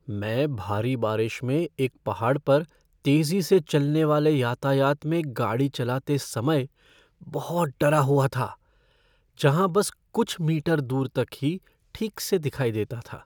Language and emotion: Hindi, fearful